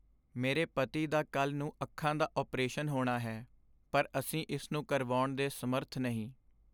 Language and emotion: Punjabi, sad